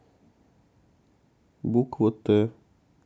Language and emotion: Russian, sad